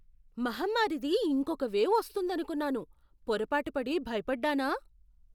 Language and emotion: Telugu, surprised